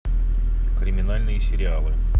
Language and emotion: Russian, neutral